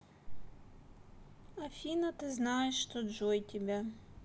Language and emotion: Russian, sad